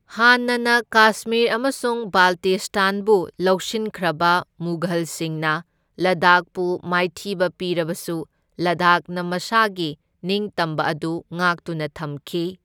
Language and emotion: Manipuri, neutral